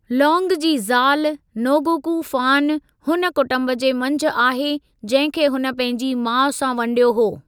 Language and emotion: Sindhi, neutral